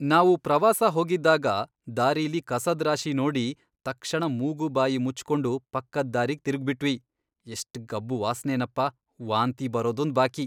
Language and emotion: Kannada, disgusted